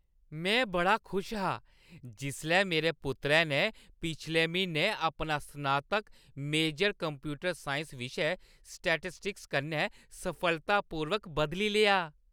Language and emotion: Dogri, happy